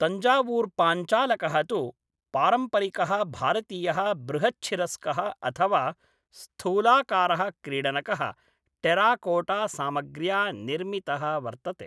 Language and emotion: Sanskrit, neutral